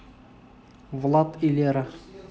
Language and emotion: Russian, neutral